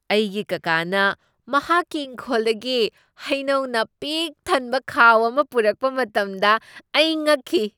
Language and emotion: Manipuri, surprised